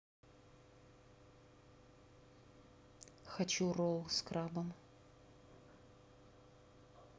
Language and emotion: Russian, neutral